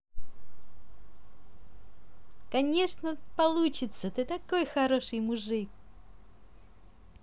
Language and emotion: Russian, positive